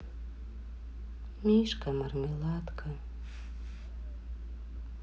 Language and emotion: Russian, sad